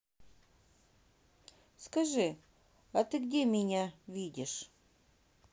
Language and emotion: Russian, neutral